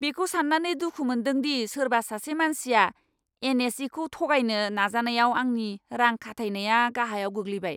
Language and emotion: Bodo, angry